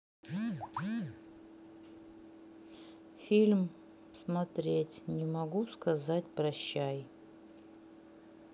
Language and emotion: Russian, neutral